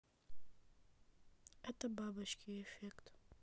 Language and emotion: Russian, neutral